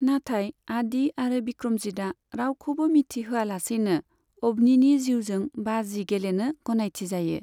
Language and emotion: Bodo, neutral